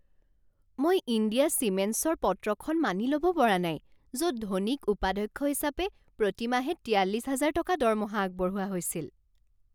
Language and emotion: Assamese, surprised